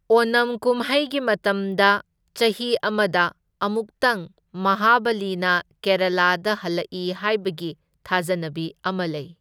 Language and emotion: Manipuri, neutral